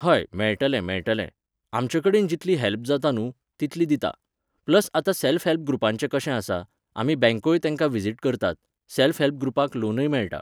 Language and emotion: Goan Konkani, neutral